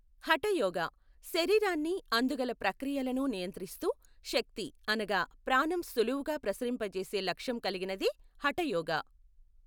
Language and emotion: Telugu, neutral